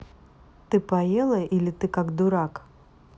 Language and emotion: Russian, neutral